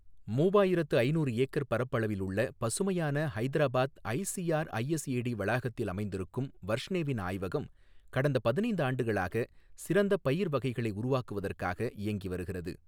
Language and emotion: Tamil, neutral